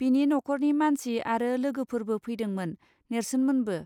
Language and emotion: Bodo, neutral